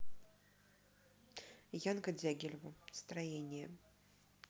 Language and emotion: Russian, neutral